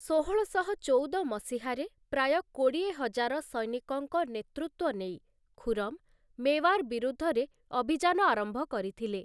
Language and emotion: Odia, neutral